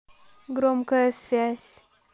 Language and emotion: Russian, neutral